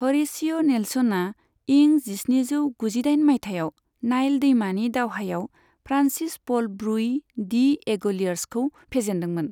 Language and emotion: Bodo, neutral